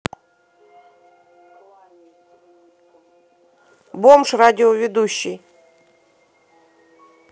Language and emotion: Russian, neutral